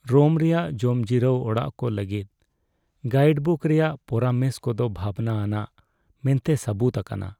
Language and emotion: Santali, sad